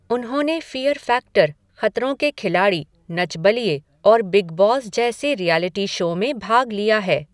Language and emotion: Hindi, neutral